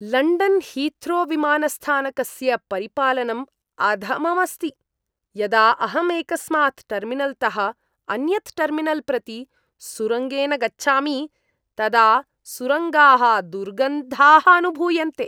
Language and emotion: Sanskrit, disgusted